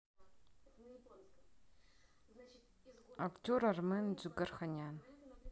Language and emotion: Russian, neutral